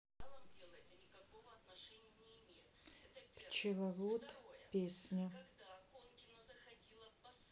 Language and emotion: Russian, neutral